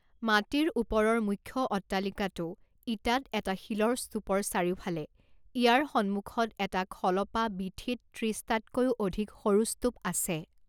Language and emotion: Assamese, neutral